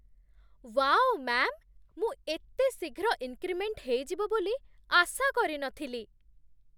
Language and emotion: Odia, surprised